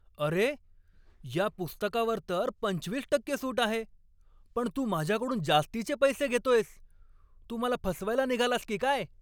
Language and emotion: Marathi, angry